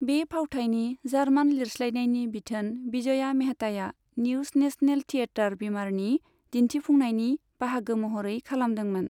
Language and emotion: Bodo, neutral